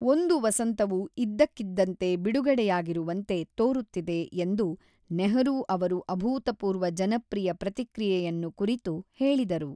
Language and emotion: Kannada, neutral